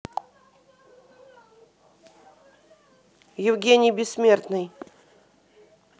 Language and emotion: Russian, neutral